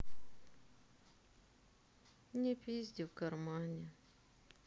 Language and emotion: Russian, sad